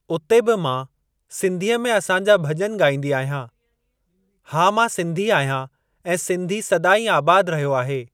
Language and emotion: Sindhi, neutral